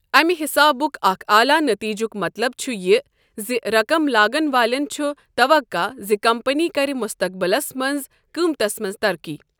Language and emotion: Kashmiri, neutral